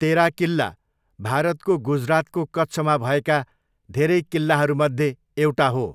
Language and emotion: Nepali, neutral